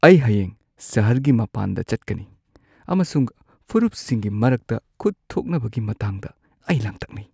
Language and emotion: Manipuri, fearful